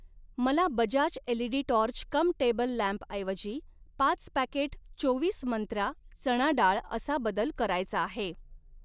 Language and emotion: Marathi, neutral